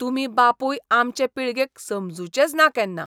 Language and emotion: Goan Konkani, disgusted